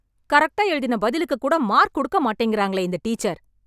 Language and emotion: Tamil, angry